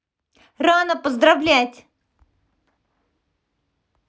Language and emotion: Russian, positive